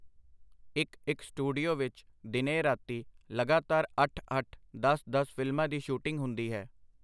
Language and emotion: Punjabi, neutral